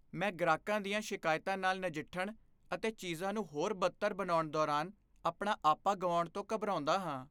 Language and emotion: Punjabi, fearful